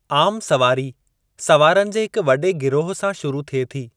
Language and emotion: Sindhi, neutral